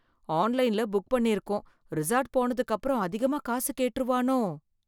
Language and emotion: Tamil, fearful